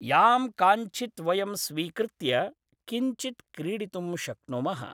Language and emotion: Sanskrit, neutral